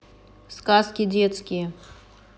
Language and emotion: Russian, neutral